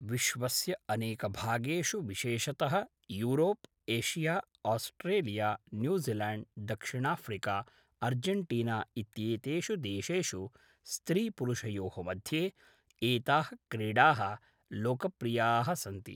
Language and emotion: Sanskrit, neutral